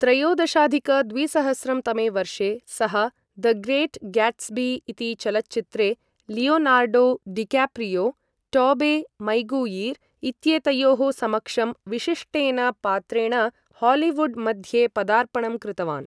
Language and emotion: Sanskrit, neutral